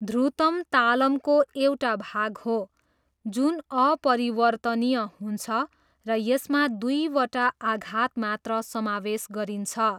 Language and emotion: Nepali, neutral